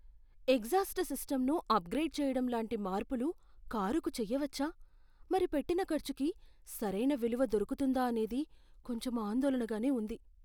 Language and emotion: Telugu, fearful